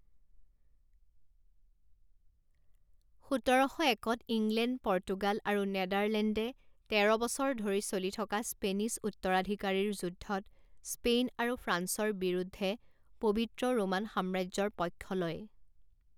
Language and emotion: Assamese, neutral